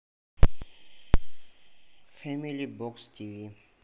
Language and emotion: Russian, neutral